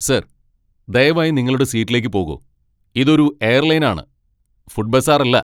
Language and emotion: Malayalam, angry